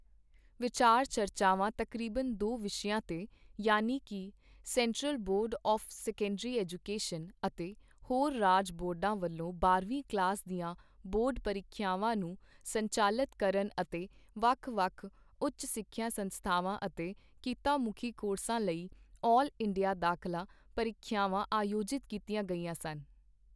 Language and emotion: Punjabi, neutral